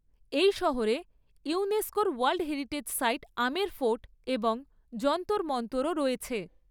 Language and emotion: Bengali, neutral